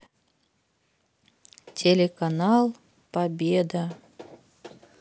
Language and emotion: Russian, sad